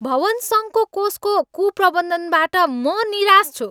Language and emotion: Nepali, angry